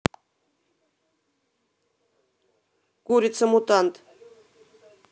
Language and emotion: Russian, neutral